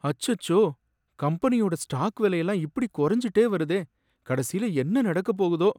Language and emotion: Tamil, sad